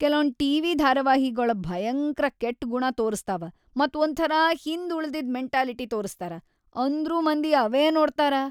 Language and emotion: Kannada, disgusted